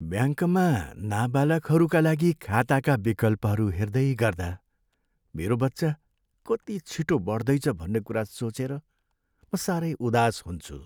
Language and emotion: Nepali, sad